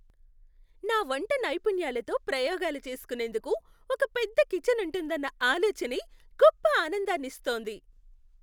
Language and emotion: Telugu, happy